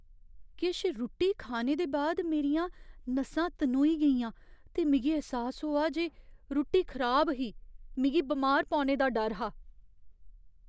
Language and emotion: Dogri, fearful